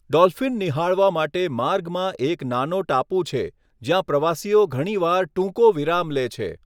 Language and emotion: Gujarati, neutral